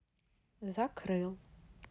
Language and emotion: Russian, neutral